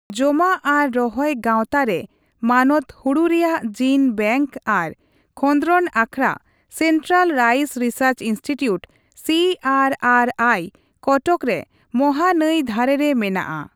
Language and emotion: Santali, neutral